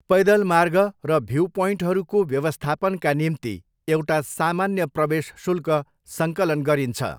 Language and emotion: Nepali, neutral